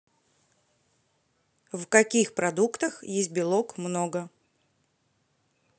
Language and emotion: Russian, neutral